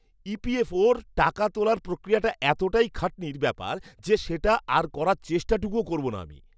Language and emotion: Bengali, disgusted